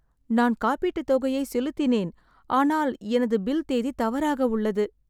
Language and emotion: Tamil, sad